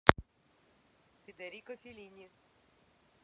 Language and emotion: Russian, neutral